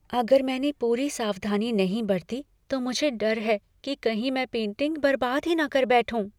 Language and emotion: Hindi, fearful